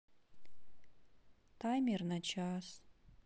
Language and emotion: Russian, sad